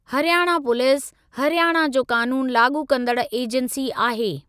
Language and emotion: Sindhi, neutral